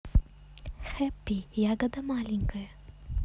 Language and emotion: Russian, positive